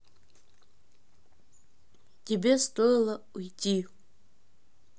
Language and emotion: Russian, neutral